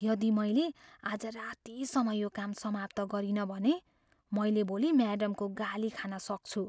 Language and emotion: Nepali, fearful